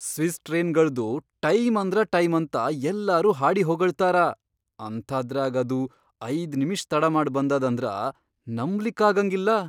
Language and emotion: Kannada, surprised